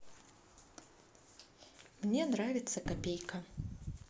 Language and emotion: Russian, neutral